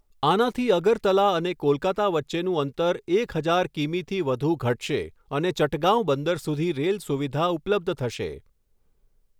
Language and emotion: Gujarati, neutral